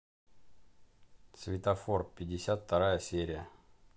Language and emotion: Russian, neutral